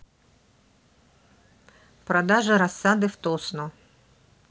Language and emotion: Russian, neutral